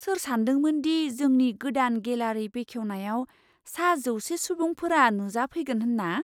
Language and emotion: Bodo, surprised